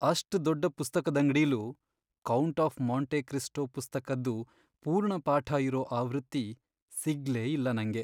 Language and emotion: Kannada, sad